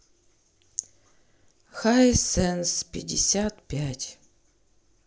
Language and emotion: Russian, neutral